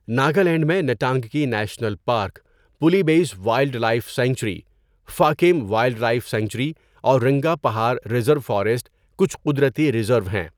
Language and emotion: Urdu, neutral